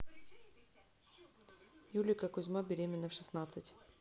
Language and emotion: Russian, neutral